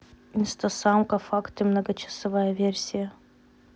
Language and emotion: Russian, neutral